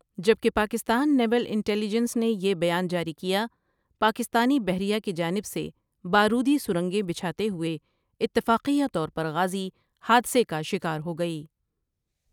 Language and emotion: Urdu, neutral